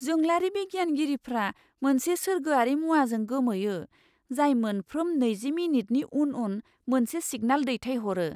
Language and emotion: Bodo, surprised